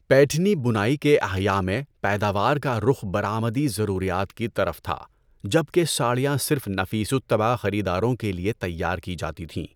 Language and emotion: Urdu, neutral